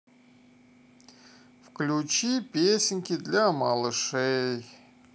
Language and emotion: Russian, sad